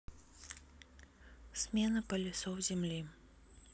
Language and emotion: Russian, neutral